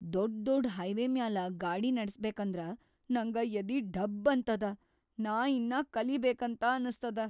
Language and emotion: Kannada, fearful